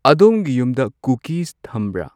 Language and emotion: Manipuri, neutral